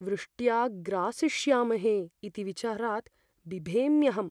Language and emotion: Sanskrit, fearful